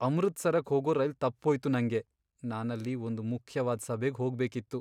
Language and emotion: Kannada, sad